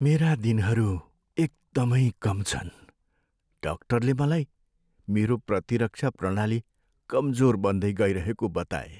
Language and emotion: Nepali, sad